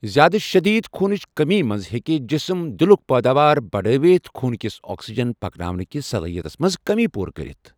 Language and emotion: Kashmiri, neutral